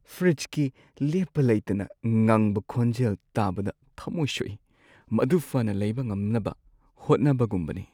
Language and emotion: Manipuri, sad